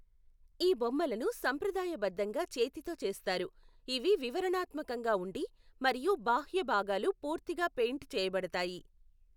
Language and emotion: Telugu, neutral